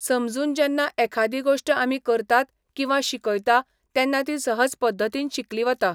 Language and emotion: Goan Konkani, neutral